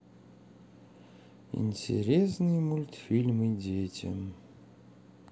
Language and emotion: Russian, sad